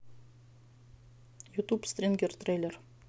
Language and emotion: Russian, neutral